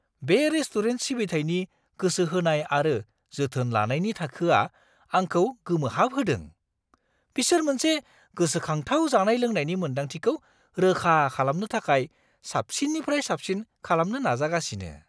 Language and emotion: Bodo, surprised